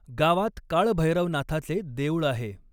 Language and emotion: Marathi, neutral